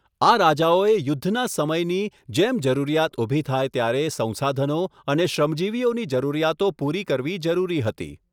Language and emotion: Gujarati, neutral